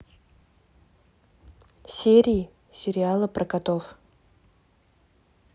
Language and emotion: Russian, neutral